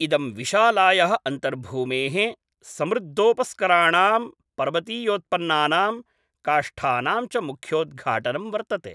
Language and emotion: Sanskrit, neutral